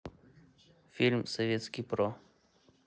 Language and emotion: Russian, neutral